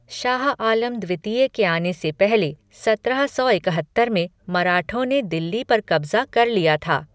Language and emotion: Hindi, neutral